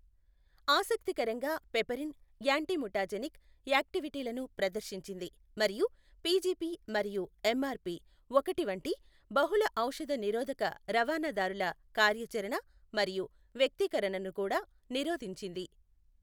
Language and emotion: Telugu, neutral